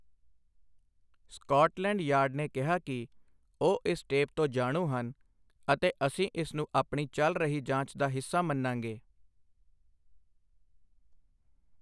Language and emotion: Punjabi, neutral